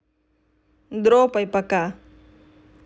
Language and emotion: Russian, neutral